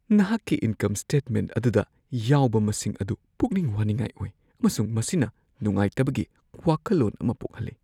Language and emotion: Manipuri, fearful